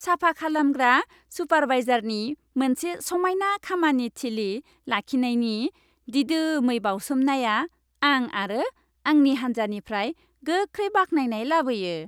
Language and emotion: Bodo, happy